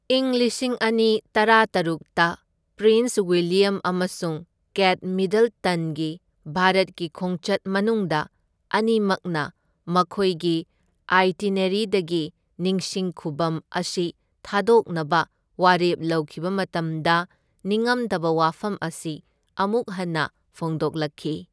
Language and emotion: Manipuri, neutral